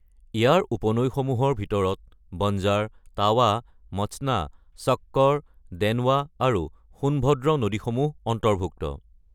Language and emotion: Assamese, neutral